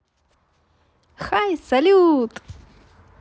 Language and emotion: Russian, positive